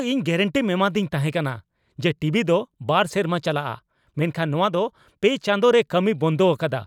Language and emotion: Santali, angry